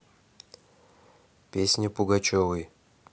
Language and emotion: Russian, neutral